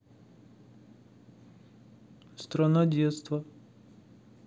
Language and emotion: Russian, neutral